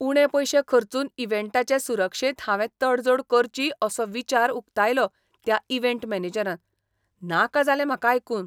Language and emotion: Goan Konkani, disgusted